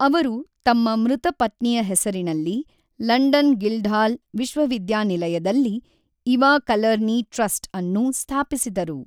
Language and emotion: Kannada, neutral